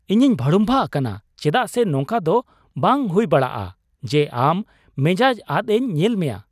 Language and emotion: Santali, surprised